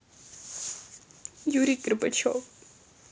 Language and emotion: Russian, sad